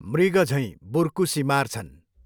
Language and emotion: Nepali, neutral